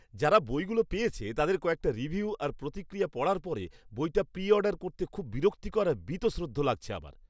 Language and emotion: Bengali, disgusted